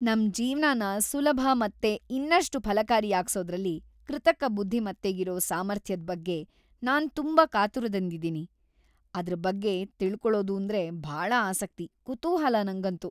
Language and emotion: Kannada, happy